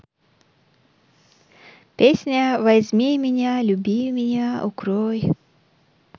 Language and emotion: Russian, neutral